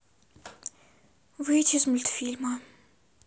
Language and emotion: Russian, sad